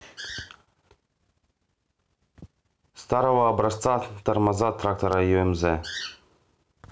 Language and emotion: Russian, neutral